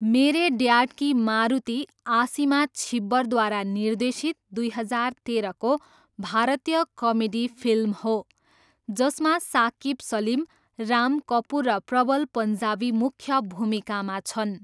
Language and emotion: Nepali, neutral